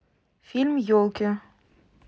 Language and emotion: Russian, neutral